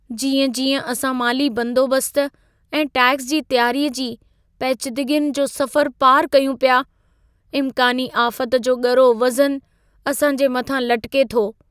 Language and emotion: Sindhi, fearful